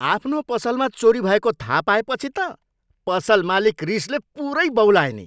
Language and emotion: Nepali, angry